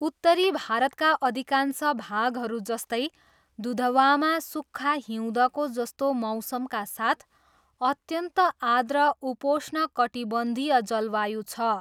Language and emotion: Nepali, neutral